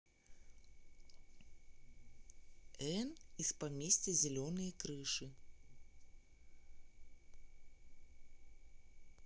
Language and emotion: Russian, neutral